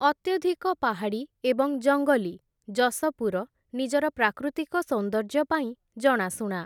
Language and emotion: Odia, neutral